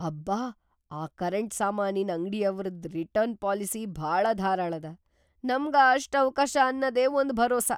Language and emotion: Kannada, surprised